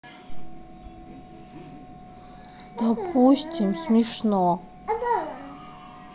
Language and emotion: Russian, sad